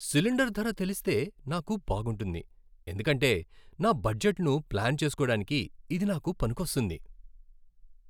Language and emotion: Telugu, happy